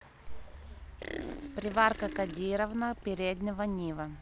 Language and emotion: Russian, neutral